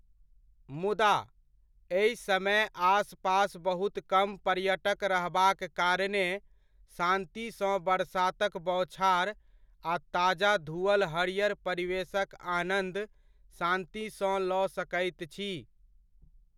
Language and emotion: Maithili, neutral